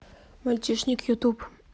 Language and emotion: Russian, neutral